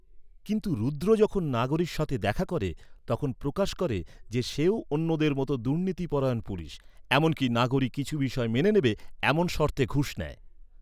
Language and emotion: Bengali, neutral